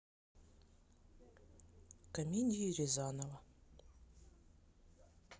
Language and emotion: Russian, sad